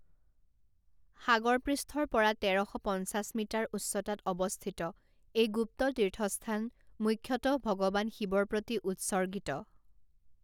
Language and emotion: Assamese, neutral